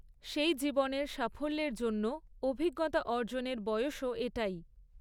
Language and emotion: Bengali, neutral